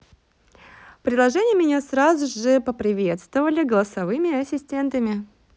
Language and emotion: Russian, positive